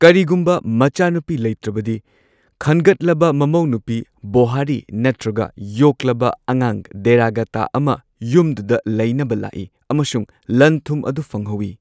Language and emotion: Manipuri, neutral